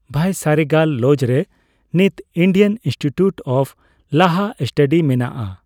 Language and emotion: Santali, neutral